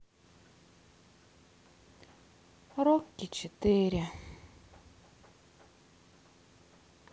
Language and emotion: Russian, sad